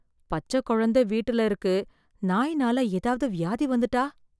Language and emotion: Tamil, fearful